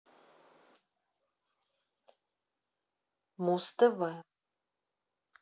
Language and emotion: Russian, neutral